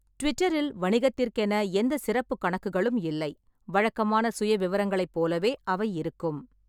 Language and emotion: Tamil, neutral